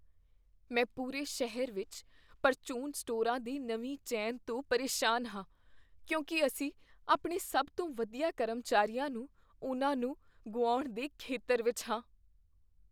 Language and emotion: Punjabi, fearful